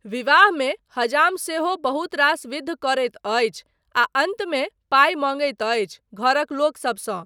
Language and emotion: Maithili, neutral